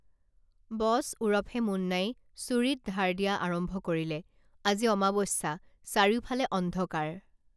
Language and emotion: Assamese, neutral